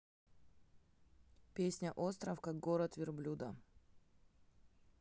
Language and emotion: Russian, neutral